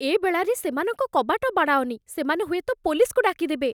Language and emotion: Odia, fearful